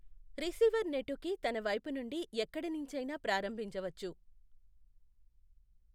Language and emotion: Telugu, neutral